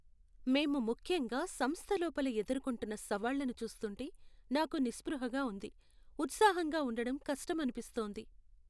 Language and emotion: Telugu, sad